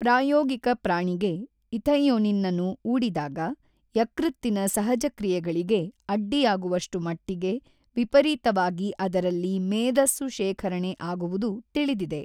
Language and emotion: Kannada, neutral